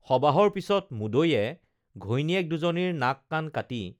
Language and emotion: Assamese, neutral